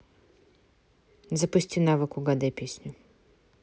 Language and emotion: Russian, neutral